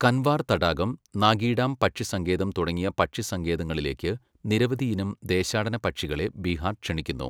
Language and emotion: Malayalam, neutral